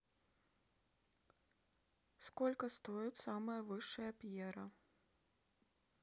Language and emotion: Russian, neutral